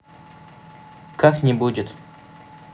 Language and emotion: Russian, neutral